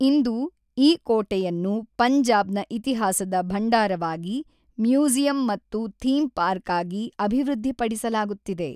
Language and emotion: Kannada, neutral